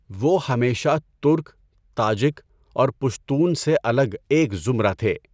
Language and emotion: Urdu, neutral